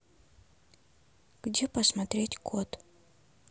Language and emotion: Russian, sad